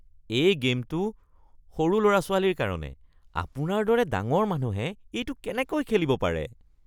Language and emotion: Assamese, disgusted